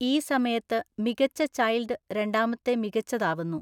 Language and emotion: Malayalam, neutral